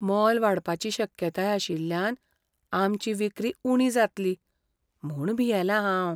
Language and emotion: Goan Konkani, fearful